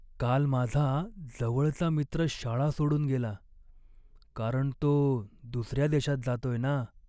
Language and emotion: Marathi, sad